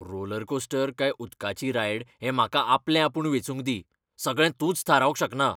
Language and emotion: Goan Konkani, angry